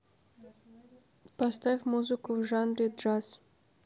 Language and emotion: Russian, neutral